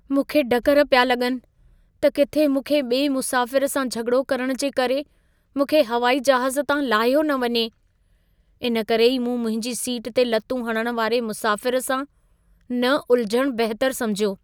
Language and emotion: Sindhi, fearful